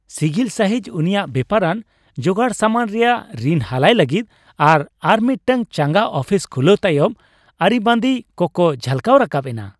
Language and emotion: Santali, happy